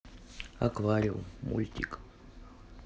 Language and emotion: Russian, neutral